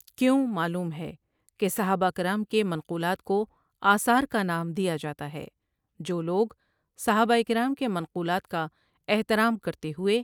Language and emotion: Urdu, neutral